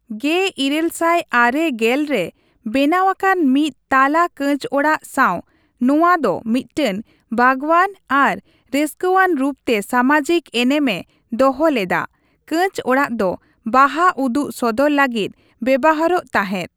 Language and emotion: Santali, neutral